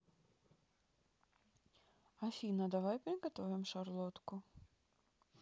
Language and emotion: Russian, neutral